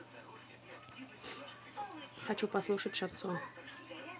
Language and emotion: Russian, neutral